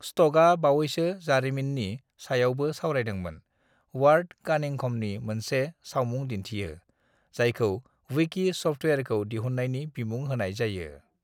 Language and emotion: Bodo, neutral